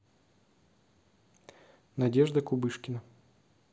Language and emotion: Russian, neutral